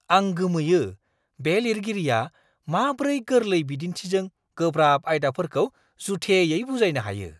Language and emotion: Bodo, surprised